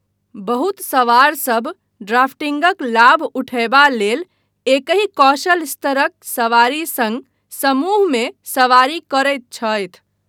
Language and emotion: Maithili, neutral